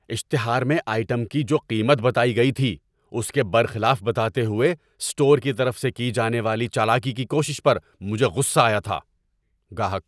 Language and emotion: Urdu, angry